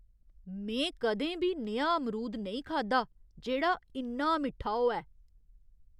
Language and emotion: Dogri, surprised